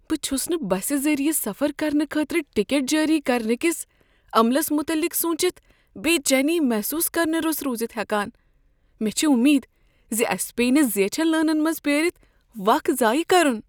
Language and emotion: Kashmiri, fearful